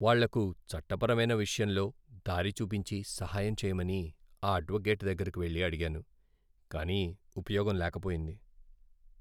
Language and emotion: Telugu, sad